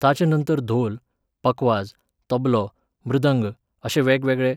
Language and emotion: Goan Konkani, neutral